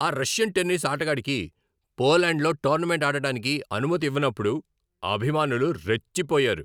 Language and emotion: Telugu, angry